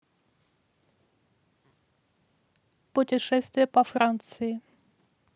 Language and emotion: Russian, neutral